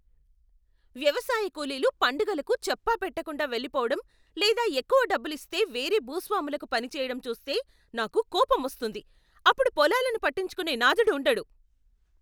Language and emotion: Telugu, angry